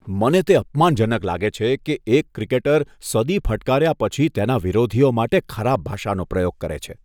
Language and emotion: Gujarati, disgusted